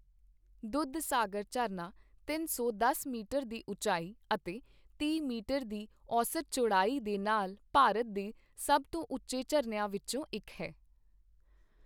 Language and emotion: Punjabi, neutral